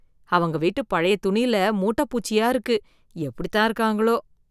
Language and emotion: Tamil, disgusted